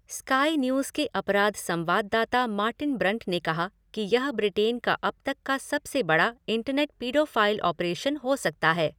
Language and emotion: Hindi, neutral